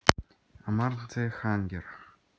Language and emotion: Russian, neutral